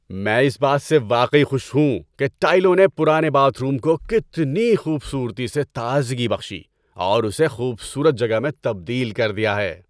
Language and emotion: Urdu, happy